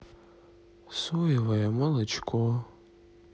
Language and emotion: Russian, sad